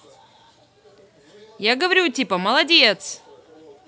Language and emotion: Russian, positive